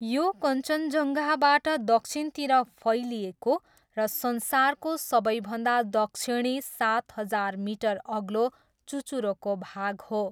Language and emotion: Nepali, neutral